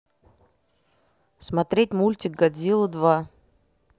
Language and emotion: Russian, neutral